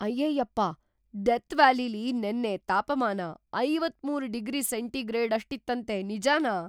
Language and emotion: Kannada, surprised